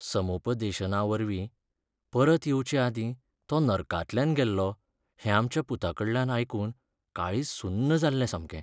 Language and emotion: Goan Konkani, sad